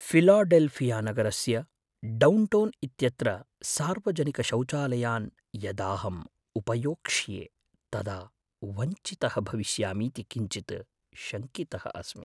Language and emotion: Sanskrit, fearful